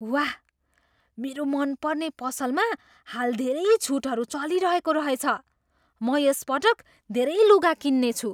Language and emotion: Nepali, surprised